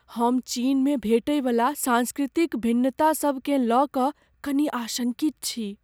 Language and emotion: Maithili, fearful